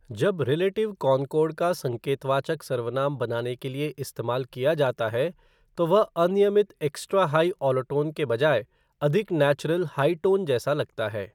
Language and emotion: Hindi, neutral